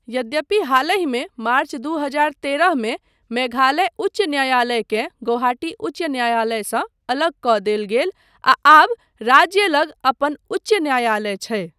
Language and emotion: Maithili, neutral